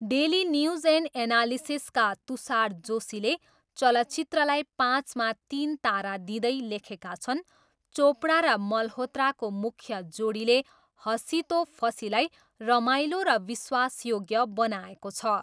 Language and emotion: Nepali, neutral